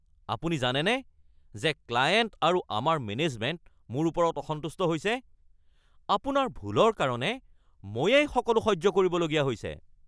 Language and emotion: Assamese, angry